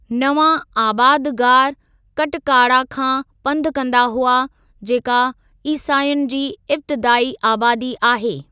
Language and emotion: Sindhi, neutral